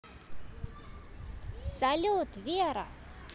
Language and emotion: Russian, positive